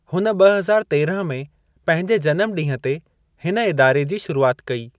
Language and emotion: Sindhi, neutral